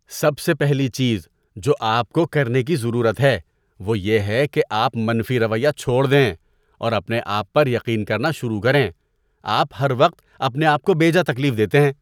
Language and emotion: Urdu, disgusted